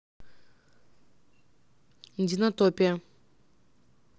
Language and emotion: Russian, neutral